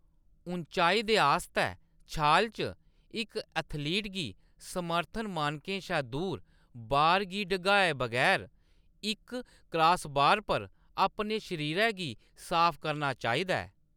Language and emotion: Dogri, neutral